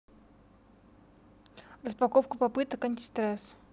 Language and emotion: Russian, neutral